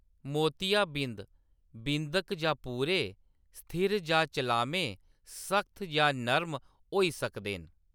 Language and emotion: Dogri, neutral